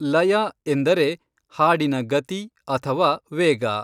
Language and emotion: Kannada, neutral